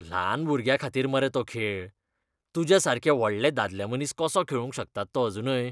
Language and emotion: Goan Konkani, disgusted